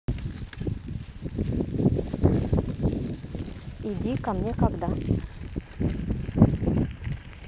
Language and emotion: Russian, neutral